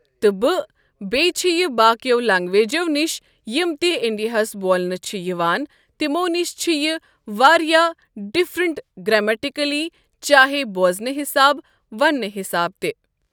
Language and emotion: Kashmiri, neutral